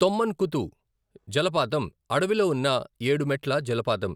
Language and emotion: Telugu, neutral